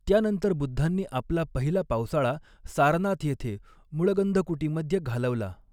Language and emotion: Marathi, neutral